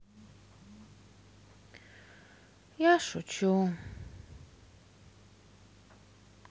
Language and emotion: Russian, sad